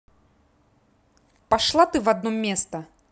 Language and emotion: Russian, angry